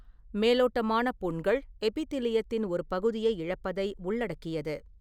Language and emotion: Tamil, neutral